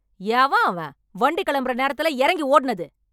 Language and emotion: Tamil, angry